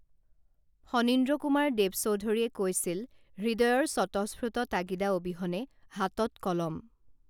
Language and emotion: Assamese, neutral